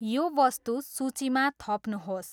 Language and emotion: Nepali, neutral